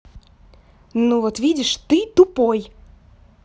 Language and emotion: Russian, angry